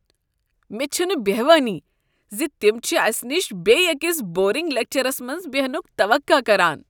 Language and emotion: Kashmiri, disgusted